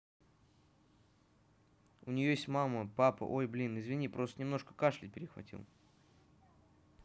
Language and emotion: Russian, neutral